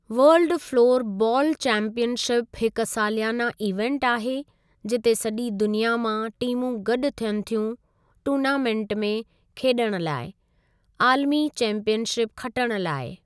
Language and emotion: Sindhi, neutral